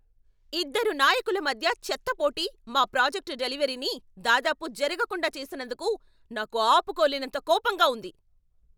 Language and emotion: Telugu, angry